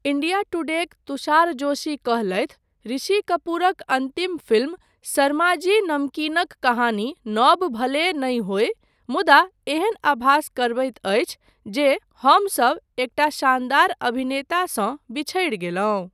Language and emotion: Maithili, neutral